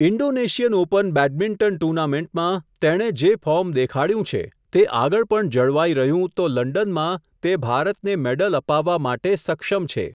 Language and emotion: Gujarati, neutral